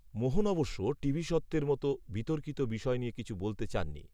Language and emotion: Bengali, neutral